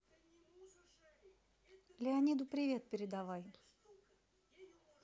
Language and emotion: Russian, neutral